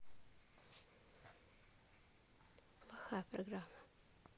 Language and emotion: Russian, neutral